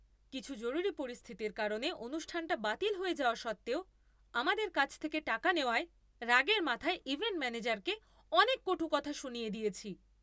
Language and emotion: Bengali, angry